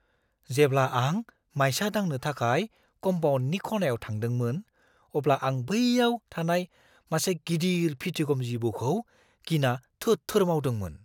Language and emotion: Bodo, fearful